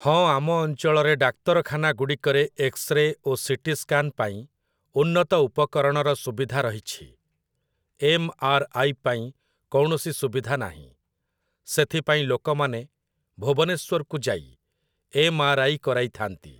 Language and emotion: Odia, neutral